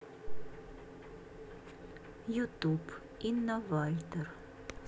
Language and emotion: Russian, neutral